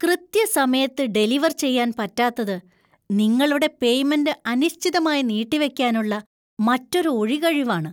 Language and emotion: Malayalam, disgusted